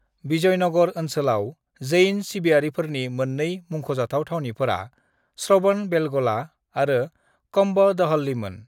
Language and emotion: Bodo, neutral